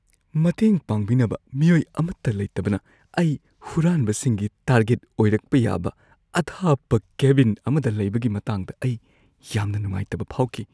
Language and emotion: Manipuri, fearful